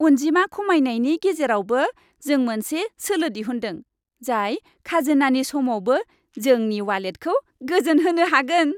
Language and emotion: Bodo, happy